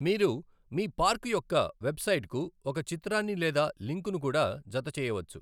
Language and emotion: Telugu, neutral